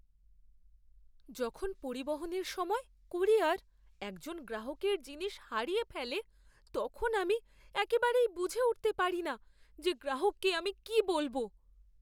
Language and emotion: Bengali, fearful